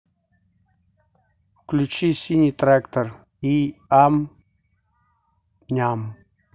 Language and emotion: Russian, neutral